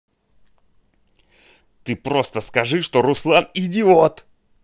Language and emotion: Russian, angry